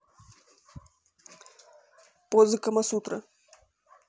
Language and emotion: Russian, neutral